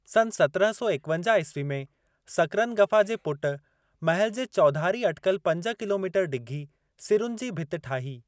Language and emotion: Sindhi, neutral